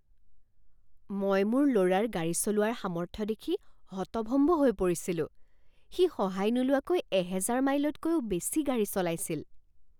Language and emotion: Assamese, surprised